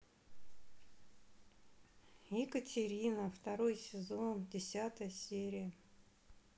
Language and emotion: Russian, neutral